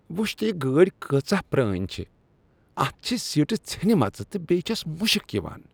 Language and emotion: Kashmiri, disgusted